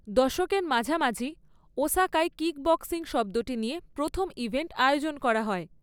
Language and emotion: Bengali, neutral